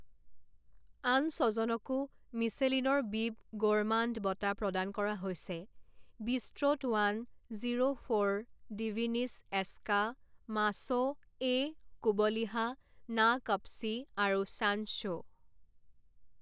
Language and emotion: Assamese, neutral